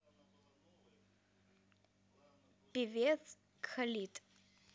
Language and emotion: Russian, neutral